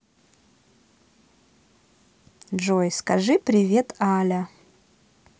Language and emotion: Russian, neutral